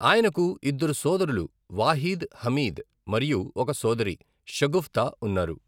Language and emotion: Telugu, neutral